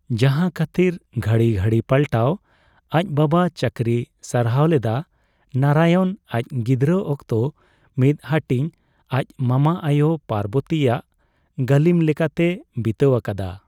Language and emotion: Santali, neutral